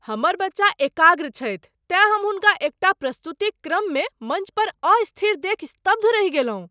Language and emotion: Maithili, surprised